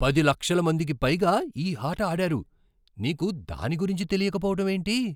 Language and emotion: Telugu, surprised